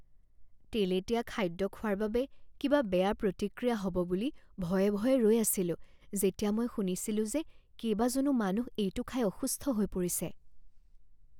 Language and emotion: Assamese, fearful